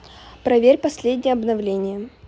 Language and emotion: Russian, neutral